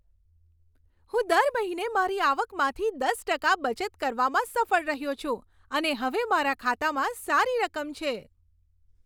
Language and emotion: Gujarati, happy